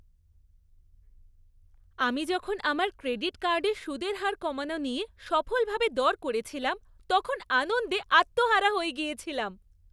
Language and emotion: Bengali, happy